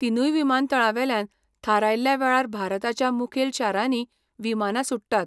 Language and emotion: Goan Konkani, neutral